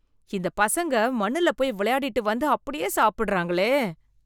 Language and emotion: Tamil, disgusted